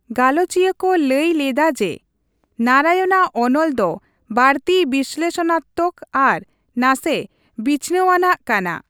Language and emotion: Santali, neutral